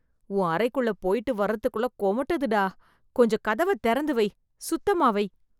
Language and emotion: Tamil, disgusted